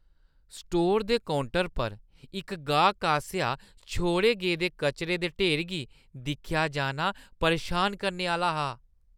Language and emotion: Dogri, disgusted